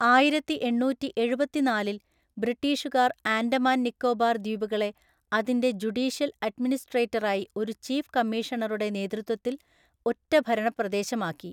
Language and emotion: Malayalam, neutral